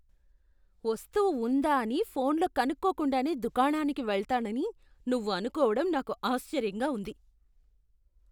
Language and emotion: Telugu, disgusted